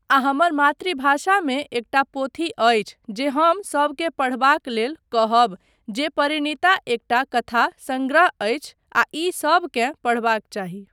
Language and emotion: Maithili, neutral